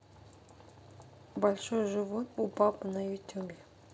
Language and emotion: Russian, neutral